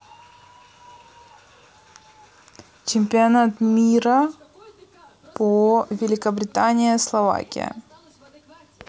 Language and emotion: Russian, neutral